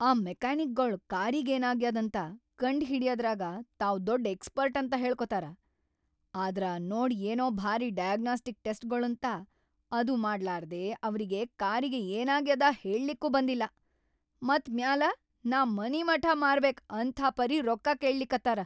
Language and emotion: Kannada, angry